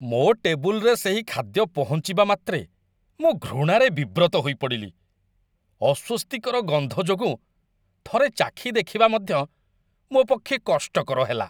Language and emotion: Odia, disgusted